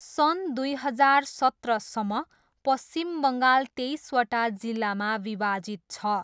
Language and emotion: Nepali, neutral